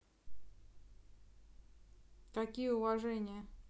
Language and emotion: Russian, neutral